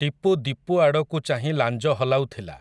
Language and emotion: Odia, neutral